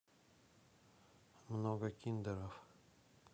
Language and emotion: Russian, neutral